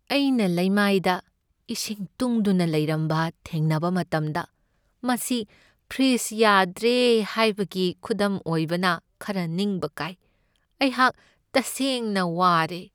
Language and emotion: Manipuri, sad